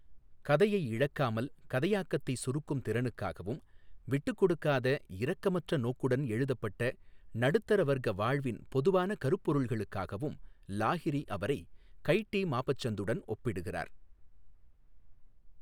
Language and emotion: Tamil, neutral